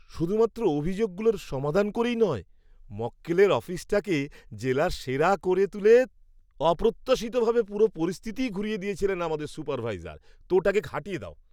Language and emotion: Bengali, surprised